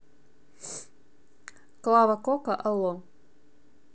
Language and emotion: Russian, neutral